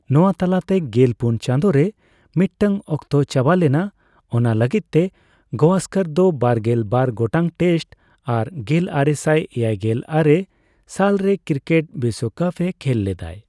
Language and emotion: Santali, neutral